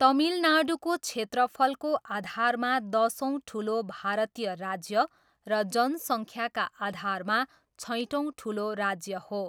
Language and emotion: Nepali, neutral